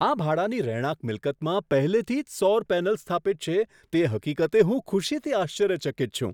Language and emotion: Gujarati, surprised